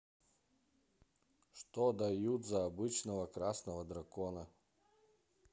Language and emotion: Russian, neutral